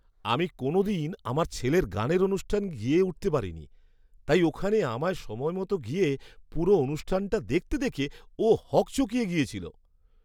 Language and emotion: Bengali, surprised